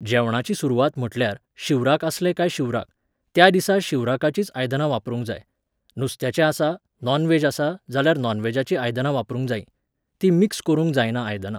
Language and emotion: Goan Konkani, neutral